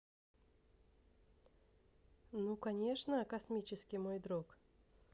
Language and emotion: Russian, neutral